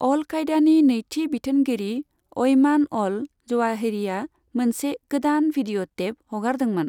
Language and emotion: Bodo, neutral